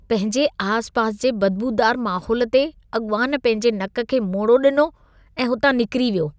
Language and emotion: Sindhi, disgusted